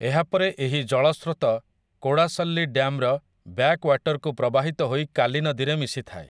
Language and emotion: Odia, neutral